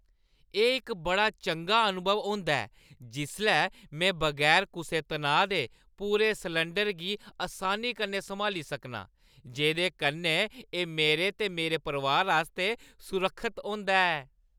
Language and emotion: Dogri, happy